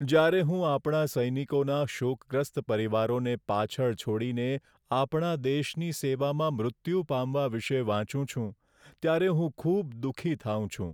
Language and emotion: Gujarati, sad